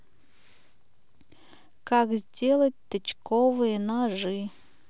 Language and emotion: Russian, neutral